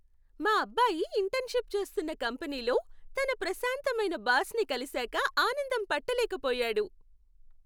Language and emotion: Telugu, happy